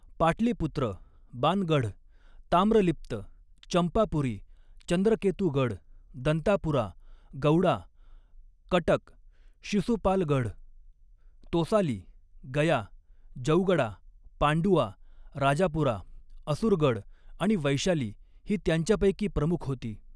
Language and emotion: Marathi, neutral